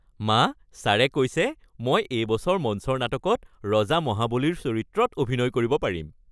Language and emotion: Assamese, happy